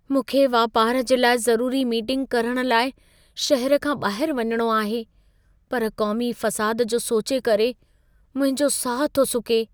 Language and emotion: Sindhi, fearful